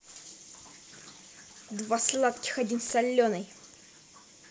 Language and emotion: Russian, angry